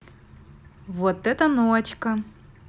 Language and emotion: Russian, positive